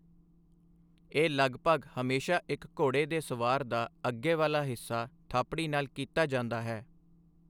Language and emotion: Punjabi, neutral